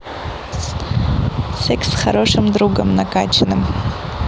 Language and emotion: Russian, neutral